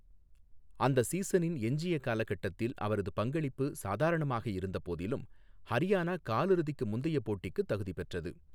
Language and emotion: Tamil, neutral